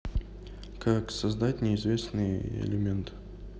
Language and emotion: Russian, neutral